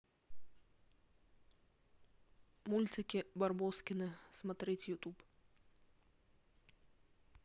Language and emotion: Russian, neutral